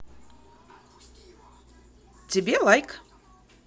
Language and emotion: Russian, positive